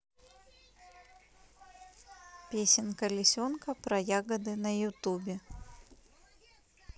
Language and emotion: Russian, neutral